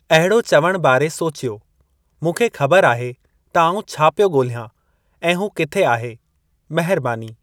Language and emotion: Sindhi, neutral